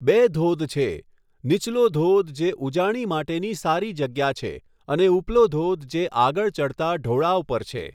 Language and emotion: Gujarati, neutral